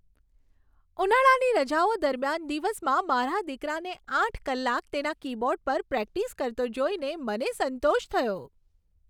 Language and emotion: Gujarati, happy